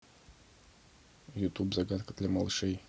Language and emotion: Russian, neutral